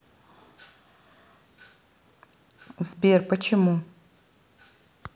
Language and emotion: Russian, neutral